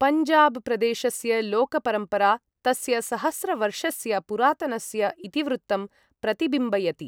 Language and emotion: Sanskrit, neutral